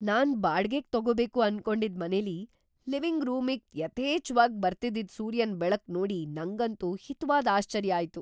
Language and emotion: Kannada, surprised